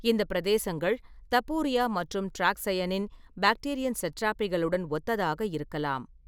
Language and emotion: Tamil, neutral